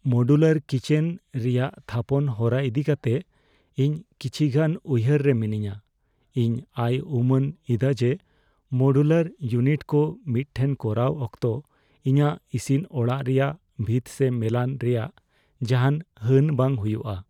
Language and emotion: Santali, fearful